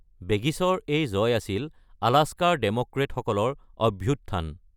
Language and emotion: Assamese, neutral